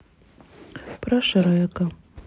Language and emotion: Russian, sad